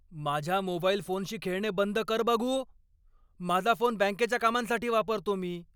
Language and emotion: Marathi, angry